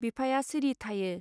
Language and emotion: Bodo, neutral